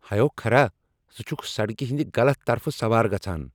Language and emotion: Kashmiri, angry